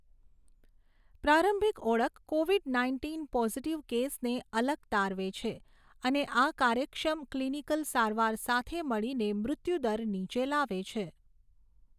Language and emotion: Gujarati, neutral